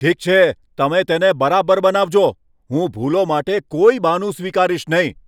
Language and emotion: Gujarati, angry